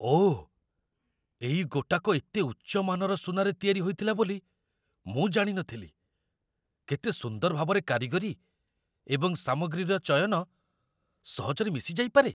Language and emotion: Odia, surprised